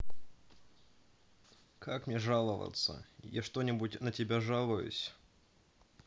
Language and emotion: Russian, sad